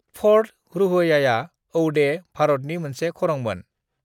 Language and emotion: Bodo, neutral